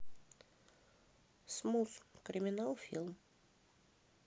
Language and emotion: Russian, neutral